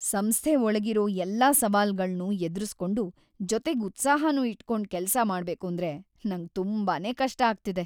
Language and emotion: Kannada, sad